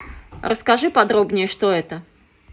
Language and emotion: Russian, neutral